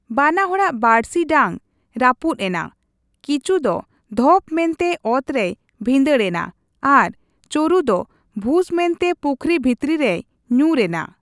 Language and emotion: Santali, neutral